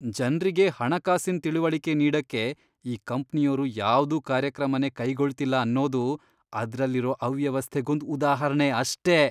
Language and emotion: Kannada, disgusted